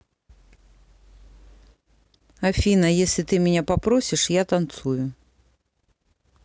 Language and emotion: Russian, neutral